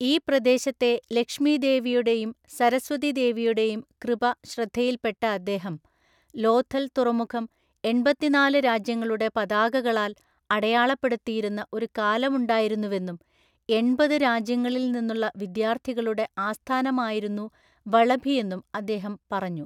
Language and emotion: Malayalam, neutral